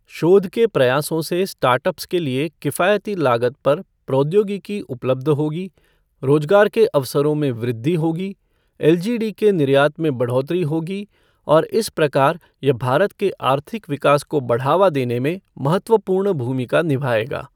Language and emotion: Hindi, neutral